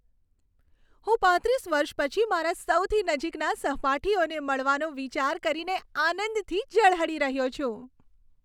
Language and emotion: Gujarati, happy